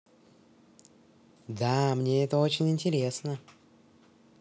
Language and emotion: Russian, neutral